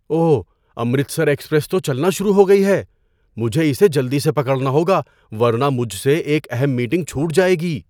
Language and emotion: Urdu, surprised